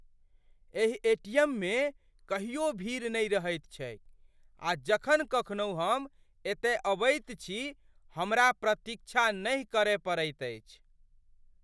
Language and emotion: Maithili, surprised